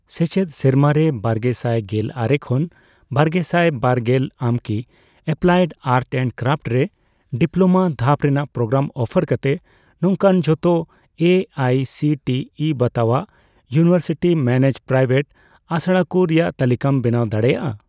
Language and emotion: Santali, neutral